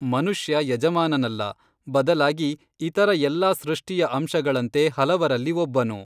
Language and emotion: Kannada, neutral